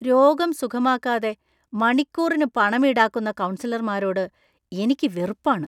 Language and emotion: Malayalam, disgusted